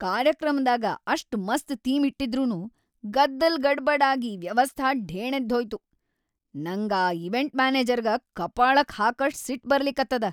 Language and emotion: Kannada, angry